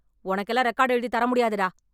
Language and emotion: Tamil, angry